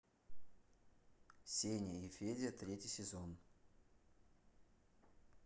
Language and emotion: Russian, neutral